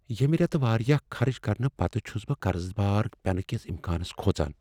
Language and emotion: Kashmiri, fearful